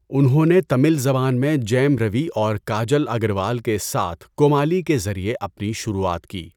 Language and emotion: Urdu, neutral